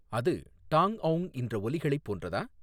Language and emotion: Tamil, neutral